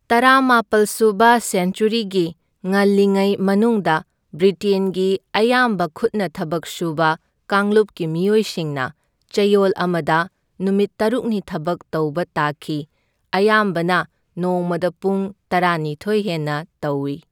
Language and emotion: Manipuri, neutral